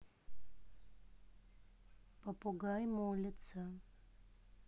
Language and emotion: Russian, neutral